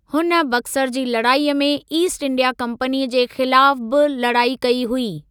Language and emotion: Sindhi, neutral